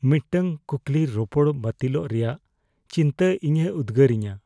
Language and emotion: Santali, fearful